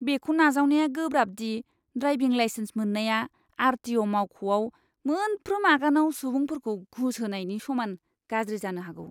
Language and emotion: Bodo, disgusted